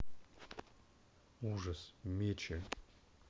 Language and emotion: Russian, neutral